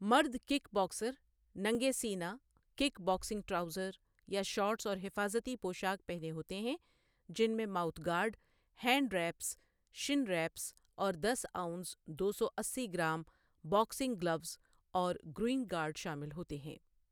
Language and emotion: Urdu, neutral